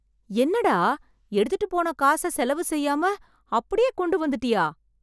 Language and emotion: Tamil, surprised